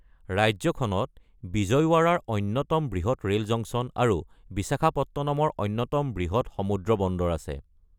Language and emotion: Assamese, neutral